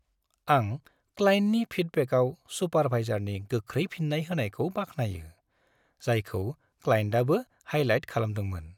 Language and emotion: Bodo, happy